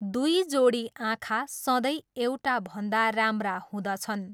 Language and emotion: Nepali, neutral